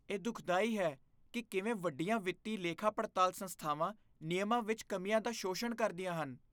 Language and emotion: Punjabi, disgusted